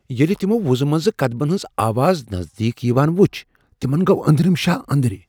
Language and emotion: Kashmiri, fearful